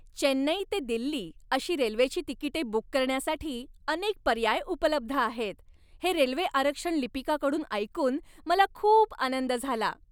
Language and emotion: Marathi, happy